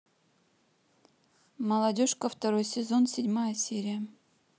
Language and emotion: Russian, neutral